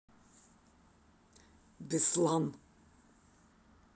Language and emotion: Russian, neutral